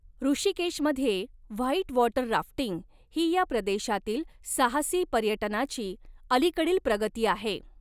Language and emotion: Marathi, neutral